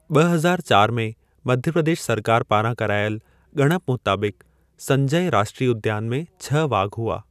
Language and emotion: Sindhi, neutral